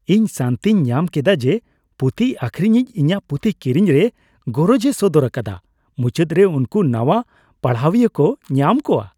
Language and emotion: Santali, happy